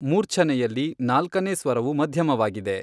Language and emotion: Kannada, neutral